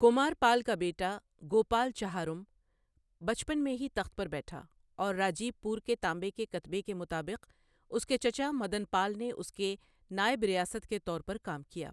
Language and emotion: Urdu, neutral